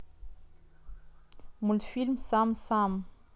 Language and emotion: Russian, neutral